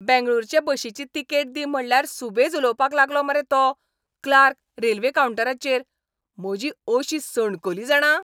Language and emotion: Goan Konkani, angry